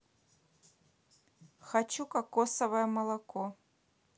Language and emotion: Russian, neutral